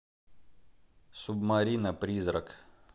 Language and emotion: Russian, neutral